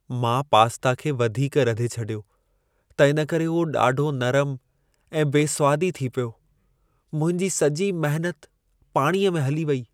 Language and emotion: Sindhi, sad